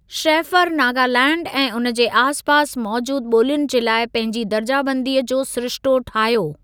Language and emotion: Sindhi, neutral